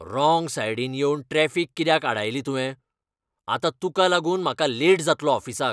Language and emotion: Goan Konkani, angry